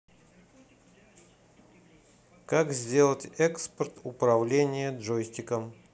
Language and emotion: Russian, neutral